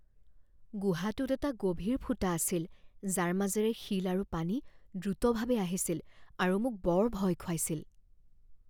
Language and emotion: Assamese, fearful